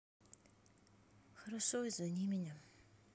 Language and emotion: Russian, sad